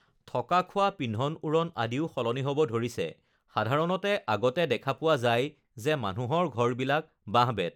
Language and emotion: Assamese, neutral